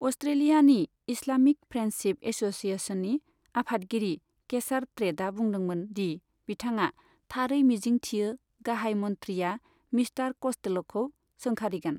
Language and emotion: Bodo, neutral